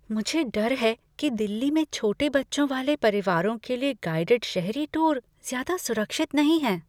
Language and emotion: Hindi, fearful